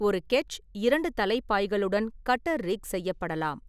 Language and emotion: Tamil, neutral